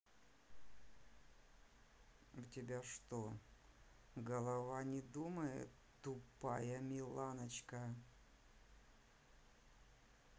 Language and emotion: Russian, sad